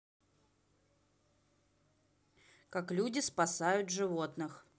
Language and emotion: Russian, neutral